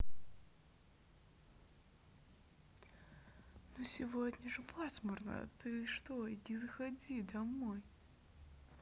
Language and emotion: Russian, neutral